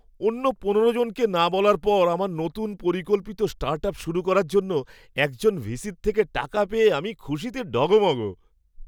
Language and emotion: Bengali, happy